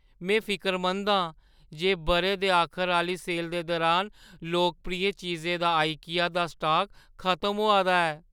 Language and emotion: Dogri, fearful